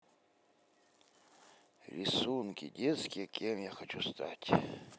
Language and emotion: Russian, sad